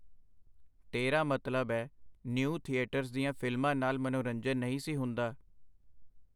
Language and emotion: Punjabi, neutral